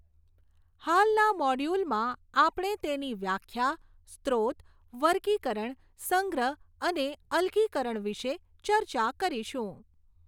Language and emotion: Gujarati, neutral